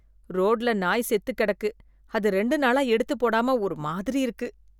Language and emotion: Tamil, disgusted